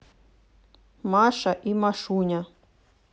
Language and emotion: Russian, neutral